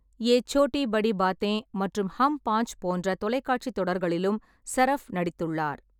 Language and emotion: Tamil, neutral